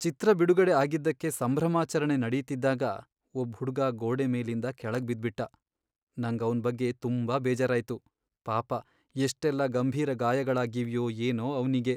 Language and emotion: Kannada, sad